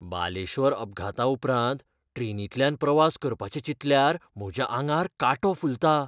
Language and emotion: Goan Konkani, fearful